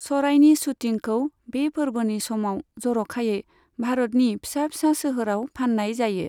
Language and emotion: Bodo, neutral